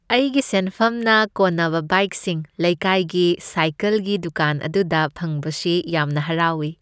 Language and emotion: Manipuri, happy